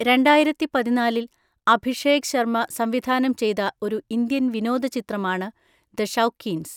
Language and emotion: Malayalam, neutral